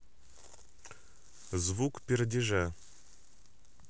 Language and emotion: Russian, neutral